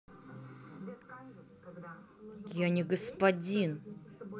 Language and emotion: Russian, angry